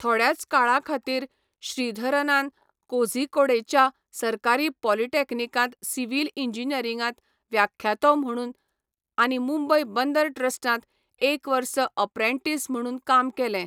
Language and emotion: Goan Konkani, neutral